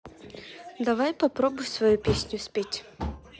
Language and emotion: Russian, neutral